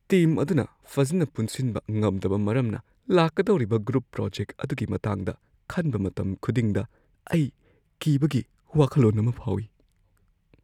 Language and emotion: Manipuri, fearful